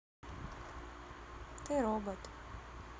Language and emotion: Russian, neutral